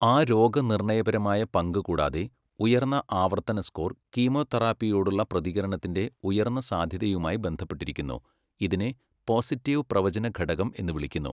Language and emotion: Malayalam, neutral